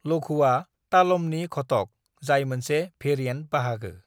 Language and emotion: Bodo, neutral